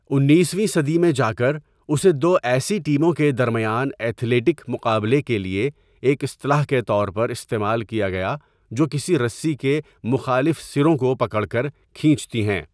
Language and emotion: Urdu, neutral